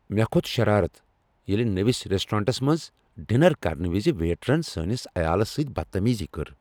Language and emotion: Kashmiri, angry